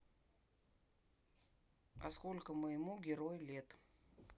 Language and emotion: Russian, neutral